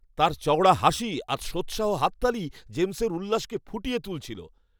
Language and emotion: Bengali, happy